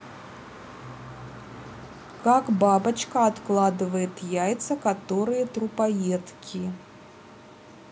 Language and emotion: Russian, neutral